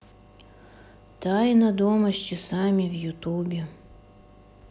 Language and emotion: Russian, sad